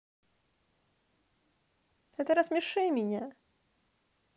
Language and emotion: Russian, neutral